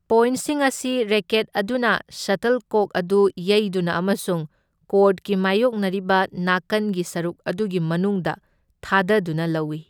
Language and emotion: Manipuri, neutral